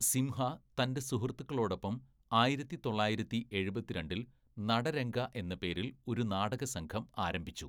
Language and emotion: Malayalam, neutral